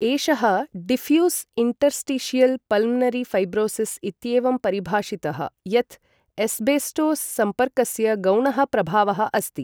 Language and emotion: Sanskrit, neutral